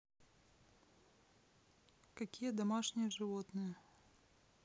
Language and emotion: Russian, neutral